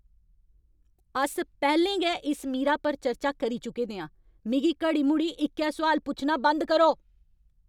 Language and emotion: Dogri, angry